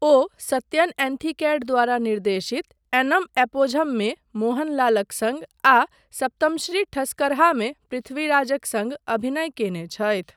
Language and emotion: Maithili, neutral